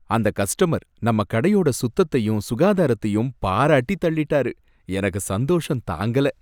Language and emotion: Tamil, happy